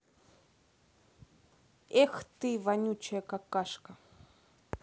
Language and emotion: Russian, angry